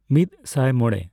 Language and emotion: Santali, neutral